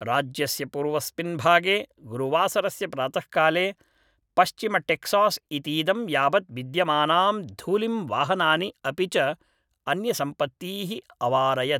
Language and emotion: Sanskrit, neutral